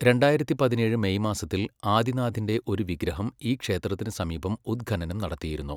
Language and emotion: Malayalam, neutral